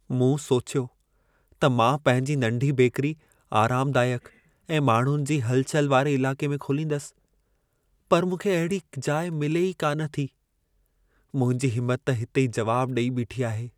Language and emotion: Sindhi, sad